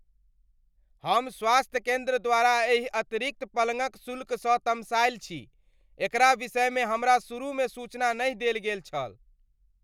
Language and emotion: Maithili, angry